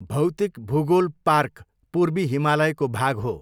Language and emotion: Nepali, neutral